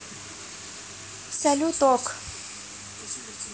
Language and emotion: Russian, neutral